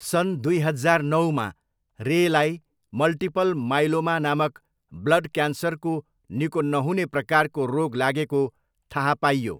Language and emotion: Nepali, neutral